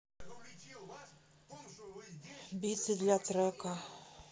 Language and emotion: Russian, sad